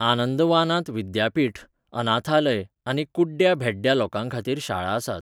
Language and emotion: Goan Konkani, neutral